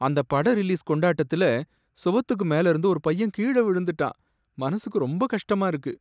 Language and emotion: Tamil, sad